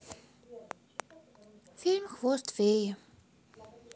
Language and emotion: Russian, sad